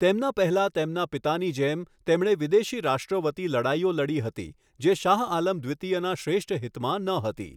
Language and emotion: Gujarati, neutral